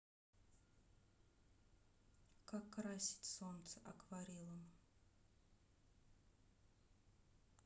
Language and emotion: Russian, neutral